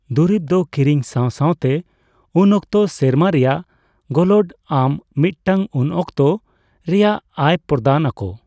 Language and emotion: Santali, neutral